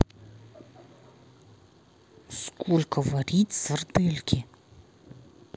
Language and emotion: Russian, angry